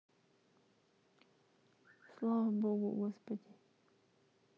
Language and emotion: Russian, sad